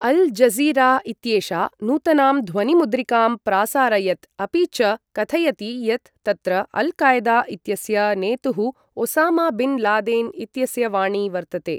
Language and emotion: Sanskrit, neutral